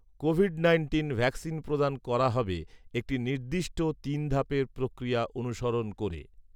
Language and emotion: Bengali, neutral